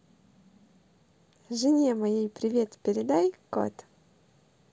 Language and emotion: Russian, positive